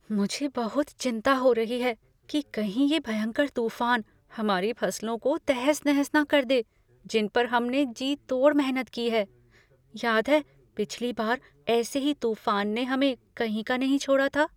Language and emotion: Hindi, fearful